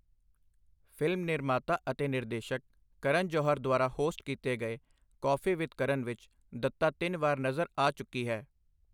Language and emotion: Punjabi, neutral